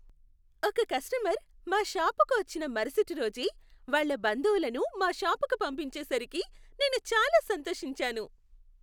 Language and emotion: Telugu, happy